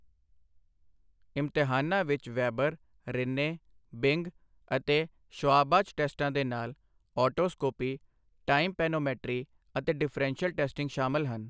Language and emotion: Punjabi, neutral